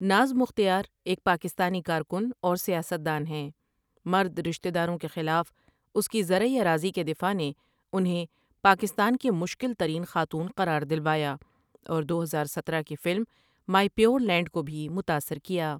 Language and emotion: Urdu, neutral